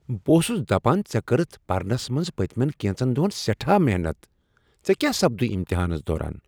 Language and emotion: Kashmiri, surprised